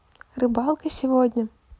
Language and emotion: Russian, neutral